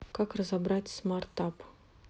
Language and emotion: Russian, neutral